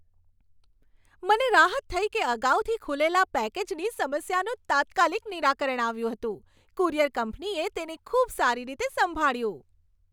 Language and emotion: Gujarati, happy